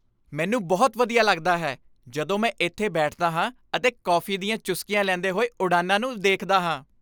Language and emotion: Punjabi, happy